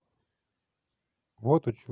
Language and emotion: Russian, neutral